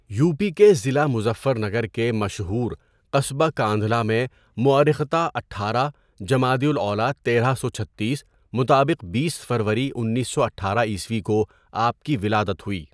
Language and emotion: Urdu, neutral